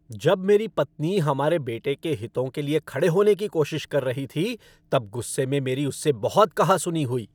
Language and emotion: Hindi, angry